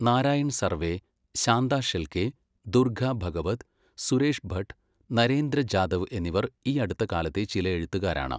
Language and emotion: Malayalam, neutral